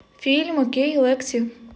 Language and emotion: Russian, neutral